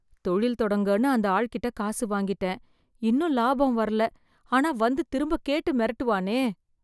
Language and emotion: Tamil, fearful